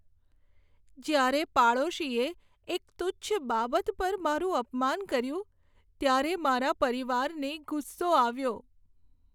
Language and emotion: Gujarati, sad